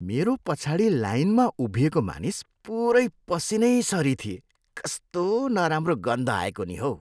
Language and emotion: Nepali, disgusted